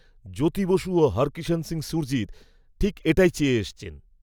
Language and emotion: Bengali, neutral